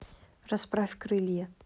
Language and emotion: Russian, neutral